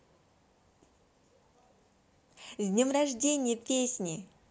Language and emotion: Russian, positive